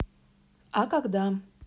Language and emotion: Russian, neutral